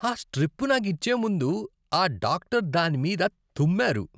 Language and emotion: Telugu, disgusted